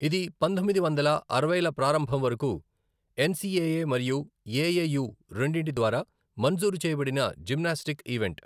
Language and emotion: Telugu, neutral